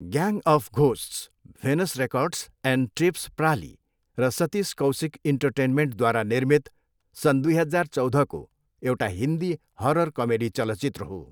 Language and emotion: Nepali, neutral